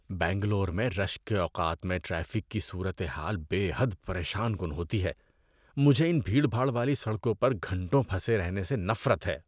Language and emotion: Urdu, disgusted